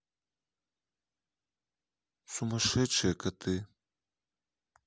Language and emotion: Russian, neutral